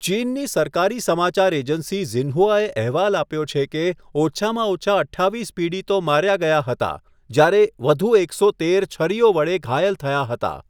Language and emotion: Gujarati, neutral